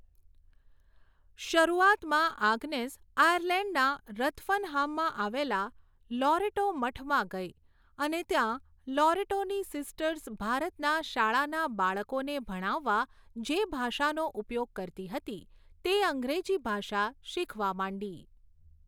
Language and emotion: Gujarati, neutral